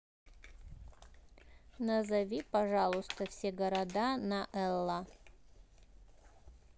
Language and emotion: Russian, neutral